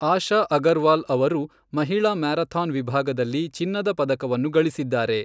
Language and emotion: Kannada, neutral